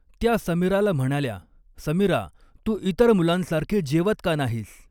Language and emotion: Marathi, neutral